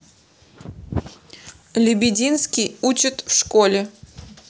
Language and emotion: Russian, neutral